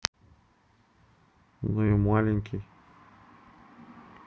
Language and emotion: Russian, neutral